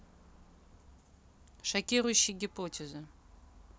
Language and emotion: Russian, neutral